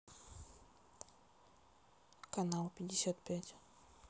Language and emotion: Russian, neutral